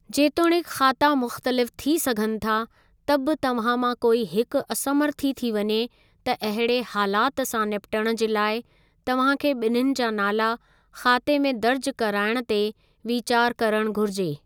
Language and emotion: Sindhi, neutral